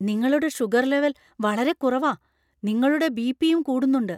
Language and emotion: Malayalam, fearful